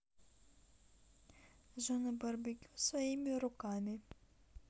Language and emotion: Russian, neutral